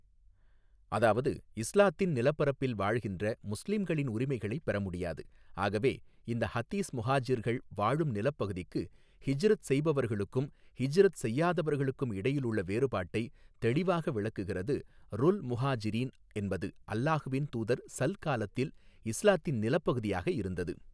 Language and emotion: Tamil, neutral